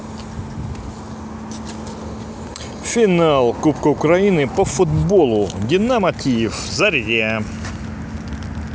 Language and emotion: Russian, positive